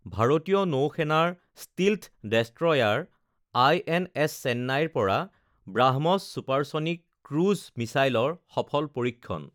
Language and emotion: Assamese, neutral